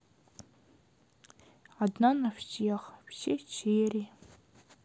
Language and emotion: Russian, sad